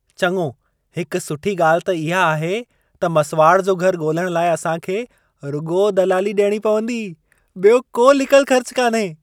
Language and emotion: Sindhi, happy